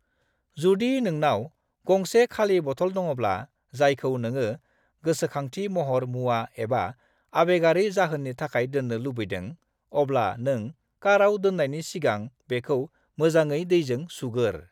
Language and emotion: Bodo, neutral